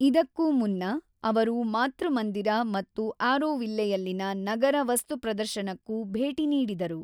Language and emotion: Kannada, neutral